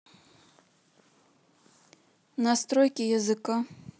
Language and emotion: Russian, neutral